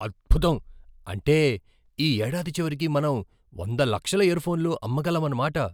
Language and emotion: Telugu, surprised